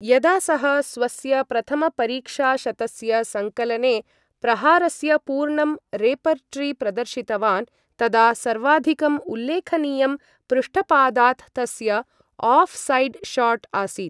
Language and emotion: Sanskrit, neutral